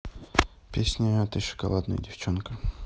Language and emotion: Russian, neutral